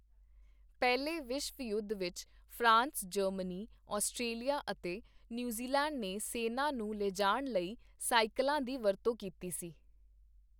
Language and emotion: Punjabi, neutral